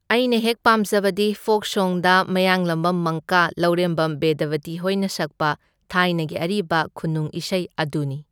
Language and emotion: Manipuri, neutral